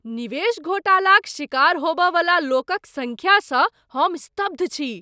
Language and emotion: Maithili, surprised